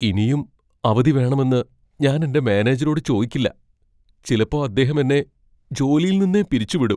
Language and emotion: Malayalam, fearful